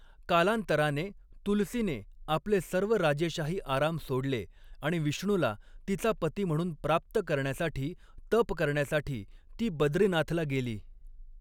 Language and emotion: Marathi, neutral